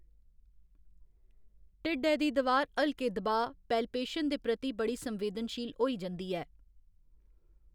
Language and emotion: Dogri, neutral